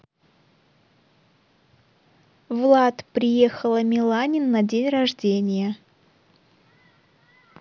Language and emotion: Russian, neutral